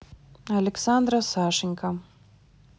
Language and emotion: Russian, neutral